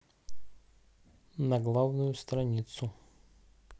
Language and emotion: Russian, neutral